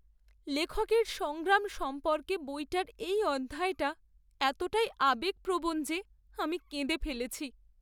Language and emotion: Bengali, sad